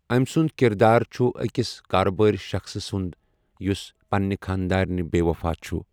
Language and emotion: Kashmiri, neutral